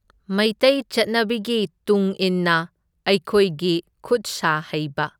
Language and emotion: Manipuri, neutral